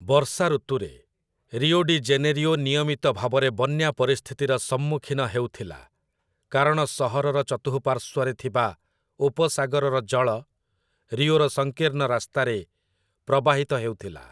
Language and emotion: Odia, neutral